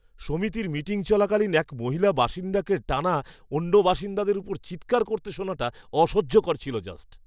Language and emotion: Bengali, disgusted